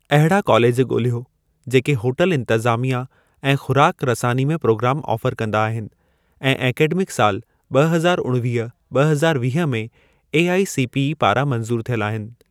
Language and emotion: Sindhi, neutral